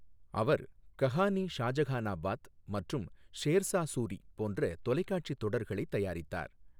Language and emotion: Tamil, neutral